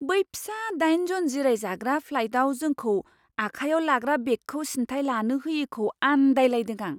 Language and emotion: Bodo, surprised